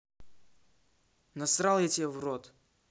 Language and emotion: Russian, angry